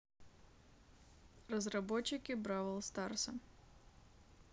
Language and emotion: Russian, neutral